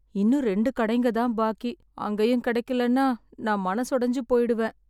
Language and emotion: Tamil, sad